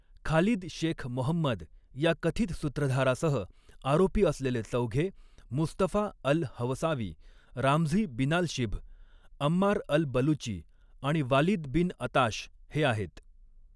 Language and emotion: Marathi, neutral